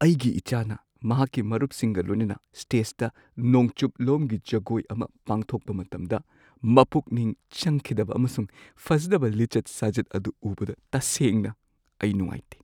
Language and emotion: Manipuri, sad